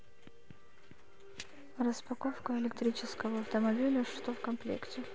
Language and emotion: Russian, neutral